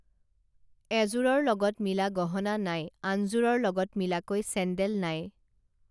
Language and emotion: Assamese, neutral